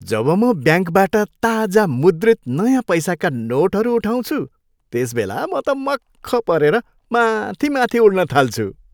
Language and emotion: Nepali, happy